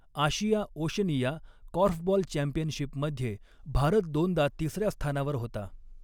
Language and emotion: Marathi, neutral